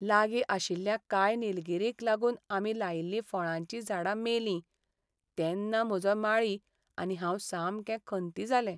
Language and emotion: Goan Konkani, sad